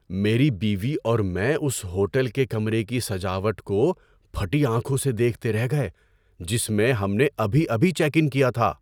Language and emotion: Urdu, surprised